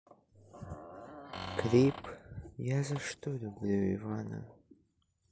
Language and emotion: Russian, sad